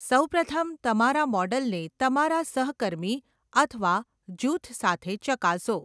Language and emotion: Gujarati, neutral